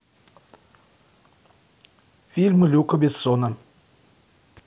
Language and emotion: Russian, neutral